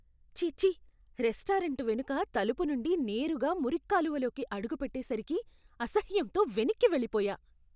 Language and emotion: Telugu, disgusted